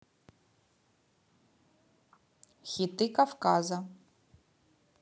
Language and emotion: Russian, neutral